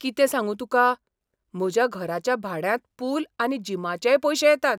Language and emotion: Goan Konkani, surprised